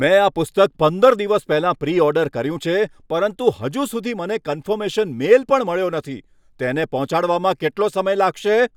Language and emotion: Gujarati, angry